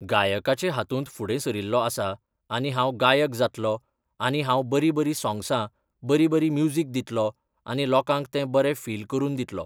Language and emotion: Goan Konkani, neutral